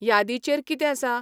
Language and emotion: Goan Konkani, neutral